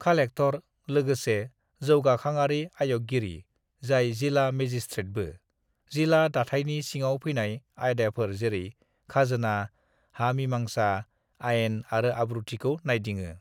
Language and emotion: Bodo, neutral